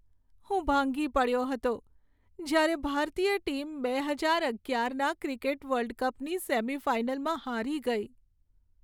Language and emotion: Gujarati, sad